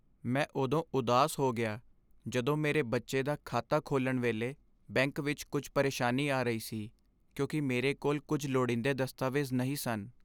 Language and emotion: Punjabi, sad